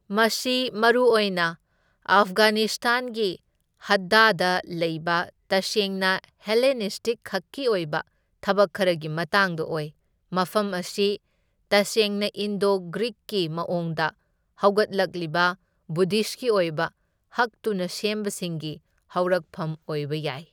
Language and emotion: Manipuri, neutral